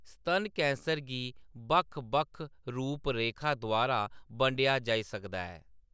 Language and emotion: Dogri, neutral